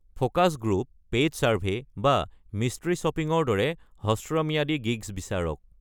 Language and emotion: Assamese, neutral